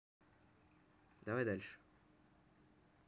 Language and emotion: Russian, neutral